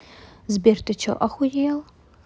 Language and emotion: Russian, angry